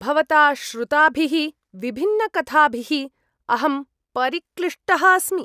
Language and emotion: Sanskrit, disgusted